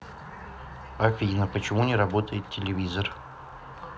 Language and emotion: Russian, neutral